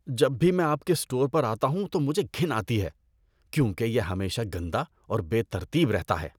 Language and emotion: Urdu, disgusted